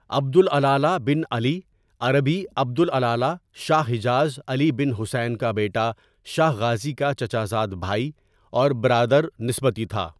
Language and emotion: Urdu, neutral